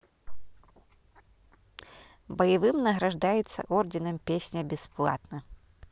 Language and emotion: Russian, neutral